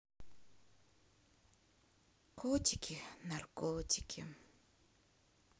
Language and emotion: Russian, sad